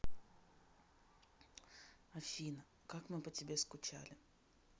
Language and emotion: Russian, neutral